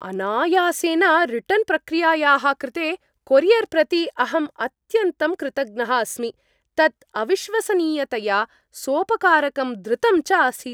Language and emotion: Sanskrit, happy